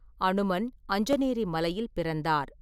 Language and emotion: Tamil, neutral